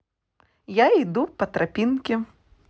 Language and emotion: Russian, positive